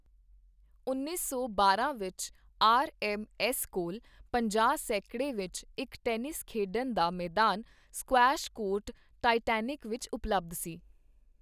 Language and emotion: Punjabi, neutral